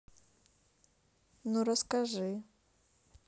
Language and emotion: Russian, neutral